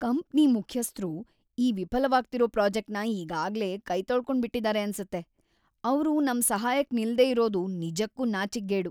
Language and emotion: Kannada, disgusted